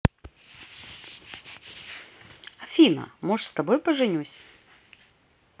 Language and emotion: Russian, positive